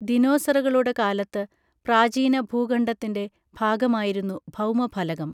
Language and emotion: Malayalam, neutral